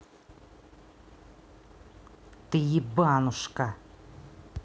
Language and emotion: Russian, angry